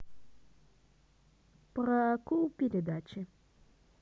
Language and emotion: Russian, positive